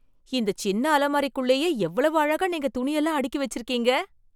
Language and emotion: Tamil, surprised